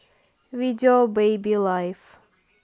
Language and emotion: Russian, neutral